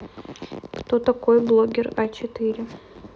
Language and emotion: Russian, neutral